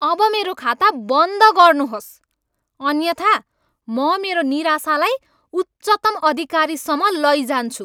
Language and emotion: Nepali, angry